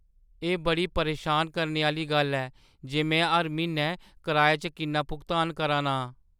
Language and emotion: Dogri, sad